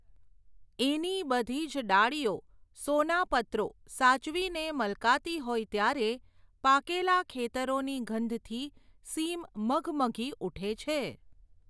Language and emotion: Gujarati, neutral